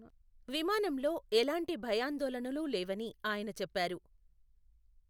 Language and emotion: Telugu, neutral